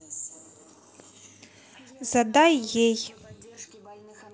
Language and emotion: Russian, neutral